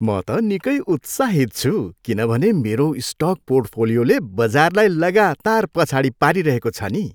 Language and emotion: Nepali, happy